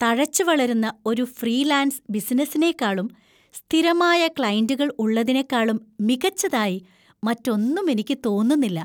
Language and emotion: Malayalam, happy